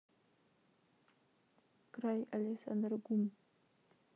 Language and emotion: Russian, neutral